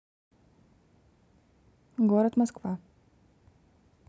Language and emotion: Russian, neutral